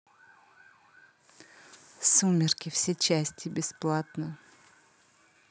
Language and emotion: Russian, neutral